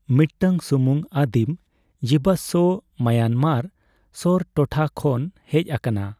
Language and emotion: Santali, neutral